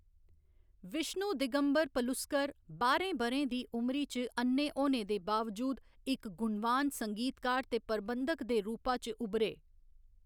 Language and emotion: Dogri, neutral